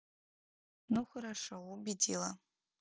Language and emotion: Russian, neutral